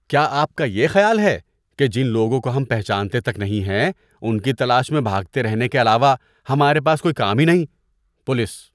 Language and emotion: Urdu, disgusted